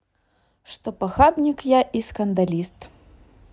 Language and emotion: Russian, neutral